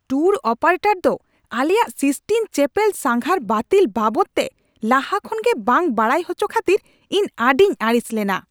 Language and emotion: Santali, angry